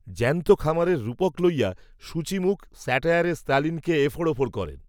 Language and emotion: Bengali, neutral